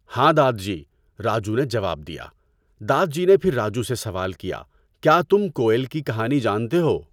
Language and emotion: Urdu, neutral